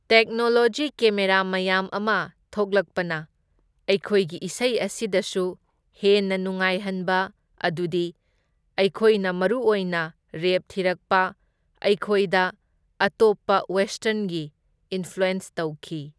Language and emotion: Manipuri, neutral